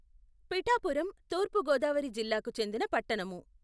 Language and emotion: Telugu, neutral